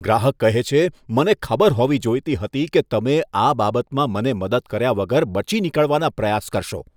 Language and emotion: Gujarati, disgusted